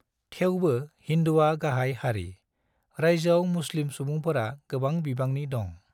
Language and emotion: Bodo, neutral